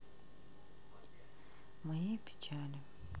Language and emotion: Russian, sad